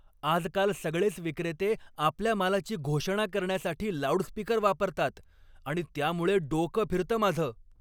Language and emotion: Marathi, angry